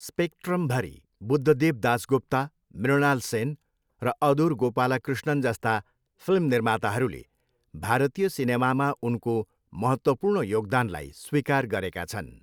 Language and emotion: Nepali, neutral